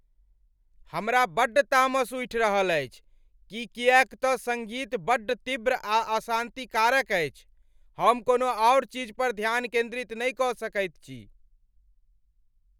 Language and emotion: Maithili, angry